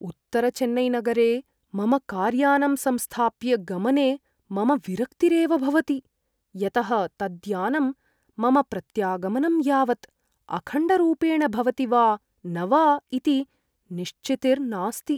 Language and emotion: Sanskrit, fearful